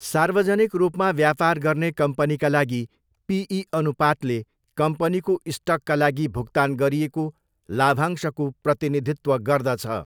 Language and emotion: Nepali, neutral